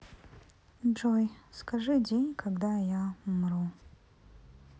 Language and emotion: Russian, sad